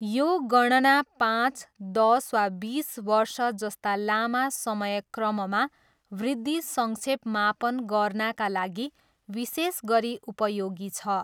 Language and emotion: Nepali, neutral